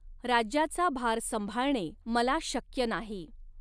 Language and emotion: Marathi, neutral